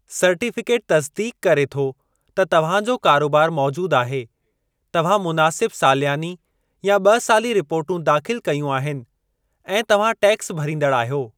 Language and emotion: Sindhi, neutral